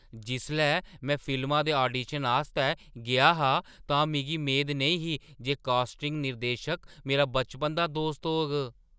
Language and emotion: Dogri, surprised